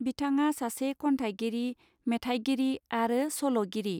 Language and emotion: Bodo, neutral